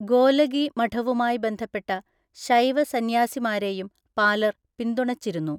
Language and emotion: Malayalam, neutral